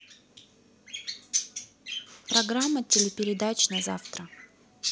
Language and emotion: Russian, neutral